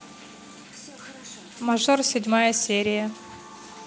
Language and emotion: Russian, neutral